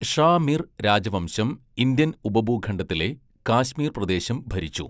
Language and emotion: Malayalam, neutral